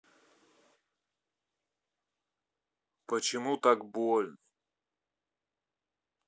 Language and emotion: Russian, sad